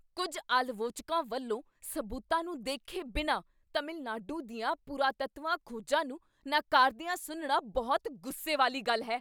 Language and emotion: Punjabi, angry